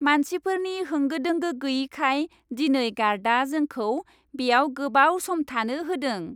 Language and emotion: Bodo, happy